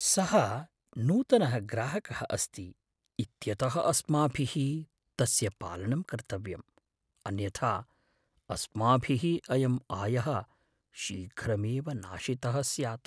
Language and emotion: Sanskrit, fearful